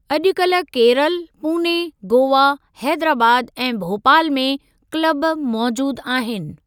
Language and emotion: Sindhi, neutral